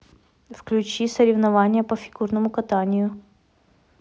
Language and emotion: Russian, neutral